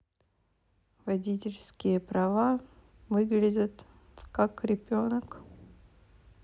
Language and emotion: Russian, neutral